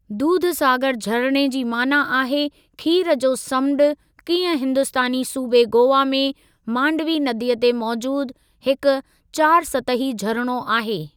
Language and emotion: Sindhi, neutral